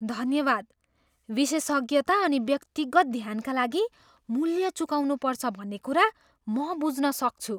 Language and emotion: Nepali, surprised